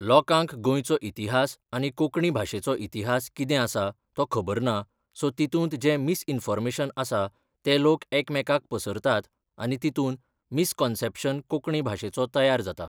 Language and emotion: Goan Konkani, neutral